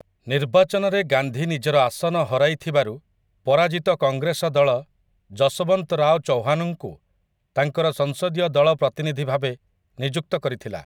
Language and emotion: Odia, neutral